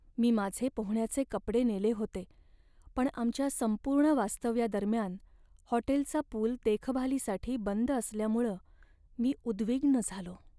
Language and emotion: Marathi, sad